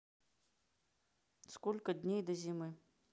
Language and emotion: Russian, neutral